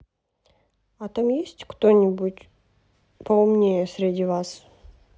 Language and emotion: Russian, neutral